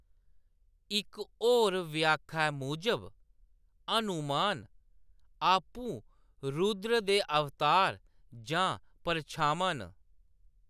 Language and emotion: Dogri, neutral